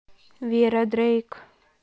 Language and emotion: Russian, neutral